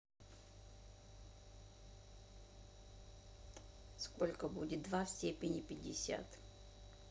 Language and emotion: Russian, neutral